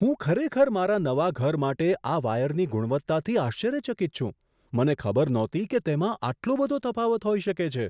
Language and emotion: Gujarati, surprised